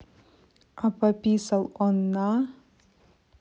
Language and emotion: Russian, neutral